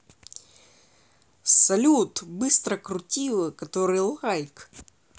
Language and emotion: Russian, positive